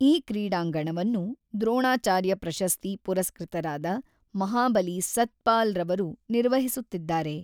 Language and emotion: Kannada, neutral